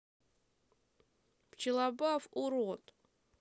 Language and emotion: Russian, sad